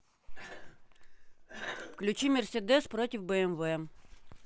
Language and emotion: Russian, neutral